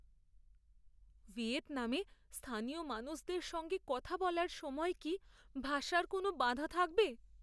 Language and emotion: Bengali, fearful